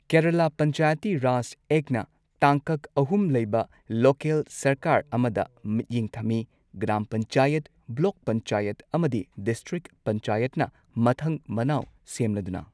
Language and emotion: Manipuri, neutral